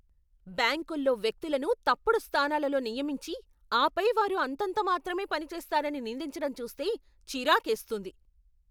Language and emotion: Telugu, angry